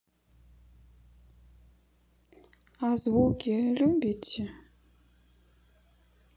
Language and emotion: Russian, sad